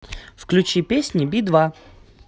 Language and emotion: Russian, positive